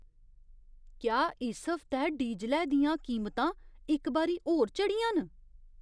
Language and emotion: Dogri, surprised